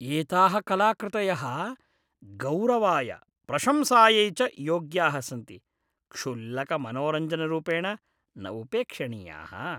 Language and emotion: Sanskrit, disgusted